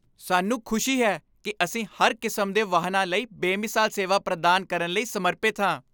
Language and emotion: Punjabi, happy